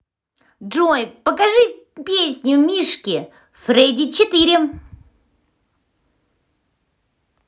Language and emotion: Russian, positive